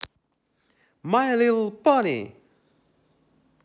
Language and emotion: Russian, positive